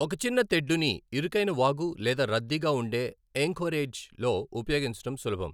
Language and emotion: Telugu, neutral